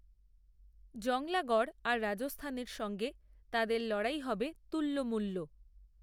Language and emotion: Bengali, neutral